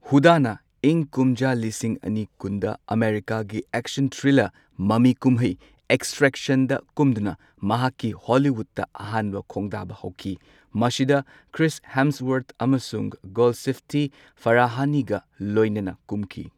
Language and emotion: Manipuri, neutral